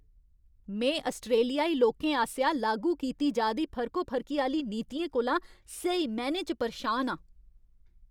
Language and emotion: Dogri, angry